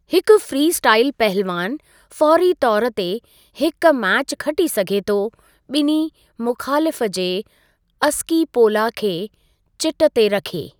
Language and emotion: Sindhi, neutral